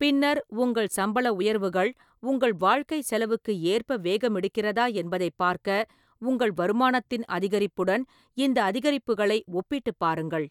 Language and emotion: Tamil, neutral